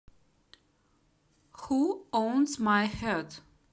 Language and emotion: Russian, neutral